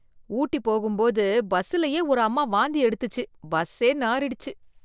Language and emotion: Tamil, disgusted